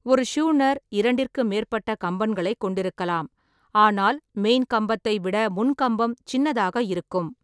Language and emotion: Tamil, neutral